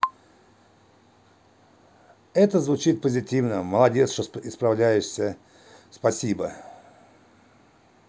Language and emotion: Russian, positive